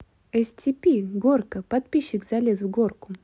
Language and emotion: Russian, neutral